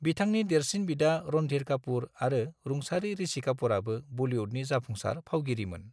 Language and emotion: Bodo, neutral